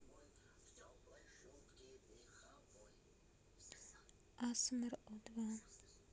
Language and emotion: Russian, sad